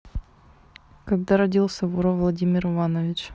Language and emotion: Russian, neutral